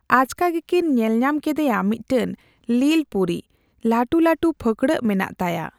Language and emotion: Santali, neutral